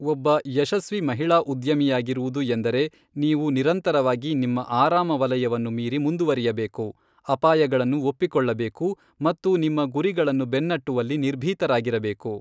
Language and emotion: Kannada, neutral